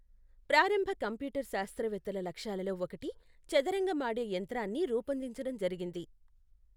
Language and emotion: Telugu, neutral